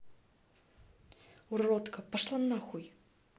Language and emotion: Russian, angry